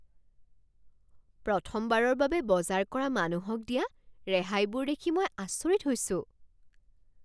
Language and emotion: Assamese, surprised